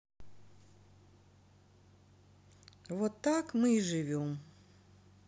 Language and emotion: Russian, sad